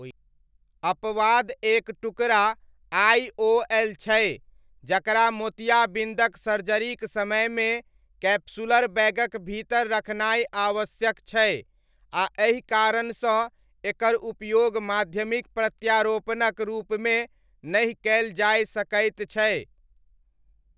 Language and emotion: Maithili, neutral